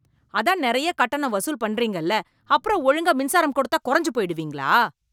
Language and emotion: Tamil, angry